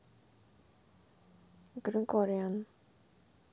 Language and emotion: Russian, neutral